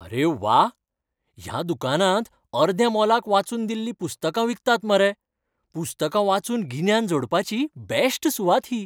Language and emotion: Goan Konkani, happy